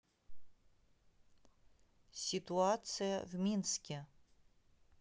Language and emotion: Russian, neutral